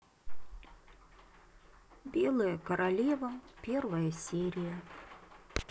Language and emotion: Russian, sad